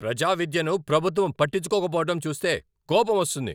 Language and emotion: Telugu, angry